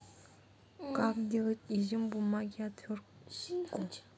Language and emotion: Russian, neutral